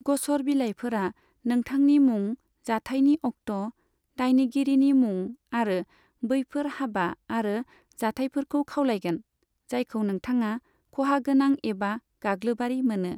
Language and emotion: Bodo, neutral